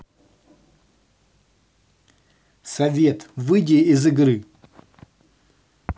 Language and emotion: Russian, angry